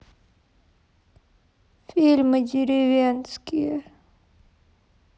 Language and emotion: Russian, sad